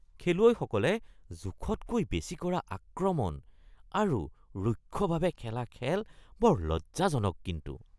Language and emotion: Assamese, disgusted